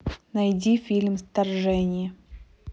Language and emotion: Russian, neutral